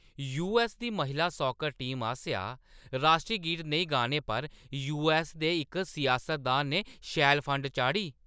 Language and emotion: Dogri, angry